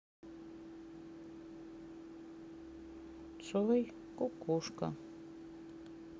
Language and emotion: Russian, sad